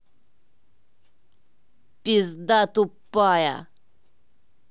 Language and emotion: Russian, angry